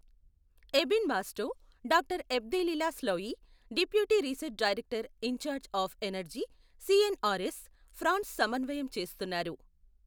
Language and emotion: Telugu, neutral